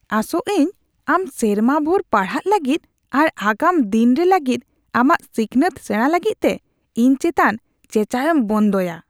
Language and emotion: Santali, disgusted